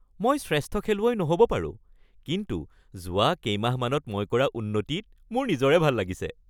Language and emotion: Assamese, happy